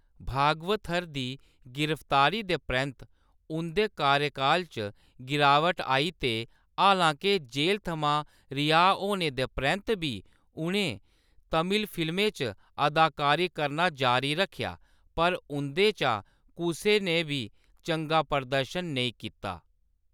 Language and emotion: Dogri, neutral